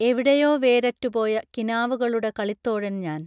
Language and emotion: Malayalam, neutral